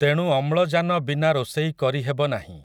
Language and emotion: Odia, neutral